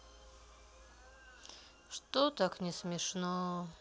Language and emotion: Russian, sad